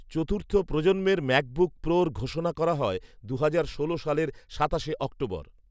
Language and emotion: Bengali, neutral